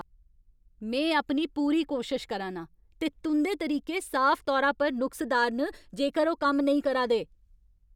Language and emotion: Dogri, angry